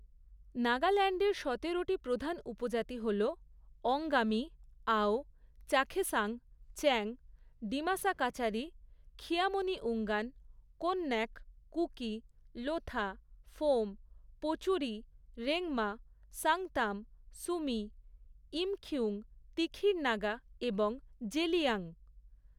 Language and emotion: Bengali, neutral